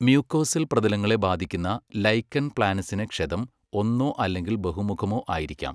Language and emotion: Malayalam, neutral